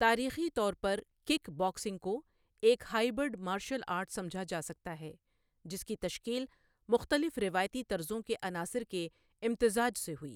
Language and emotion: Urdu, neutral